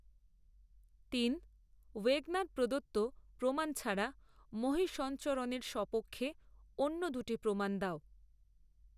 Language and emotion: Bengali, neutral